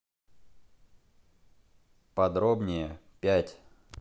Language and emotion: Russian, neutral